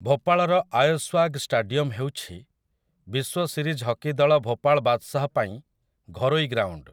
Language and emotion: Odia, neutral